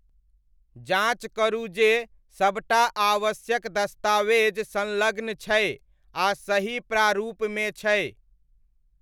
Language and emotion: Maithili, neutral